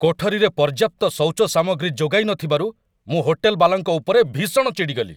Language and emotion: Odia, angry